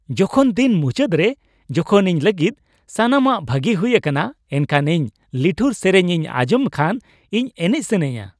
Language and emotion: Santali, happy